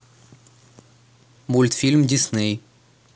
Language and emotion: Russian, neutral